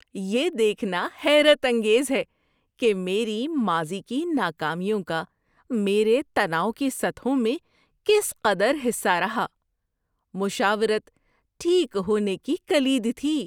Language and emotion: Urdu, surprised